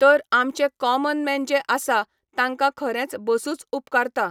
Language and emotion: Goan Konkani, neutral